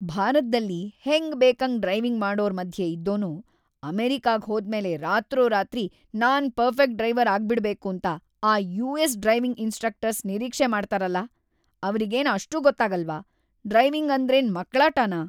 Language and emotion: Kannada, angry